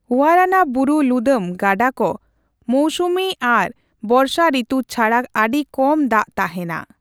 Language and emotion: Santali, neutral